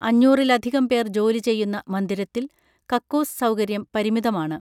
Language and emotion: Malayalam, neutral